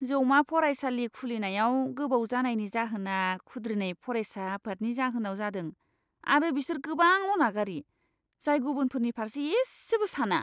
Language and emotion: Bodo, disgusted